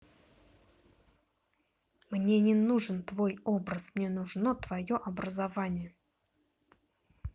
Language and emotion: Russian, angry